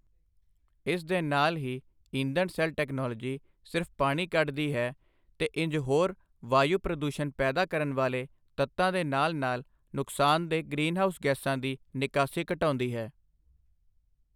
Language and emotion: Punjabi, neutral